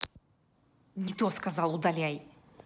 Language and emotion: Russian, angry